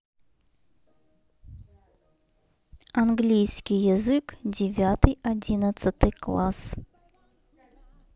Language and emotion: Russian, neutral